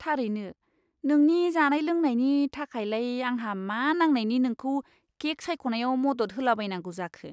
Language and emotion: Bodo, disgusted